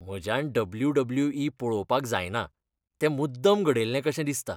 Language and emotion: Goan Konkani, disgusted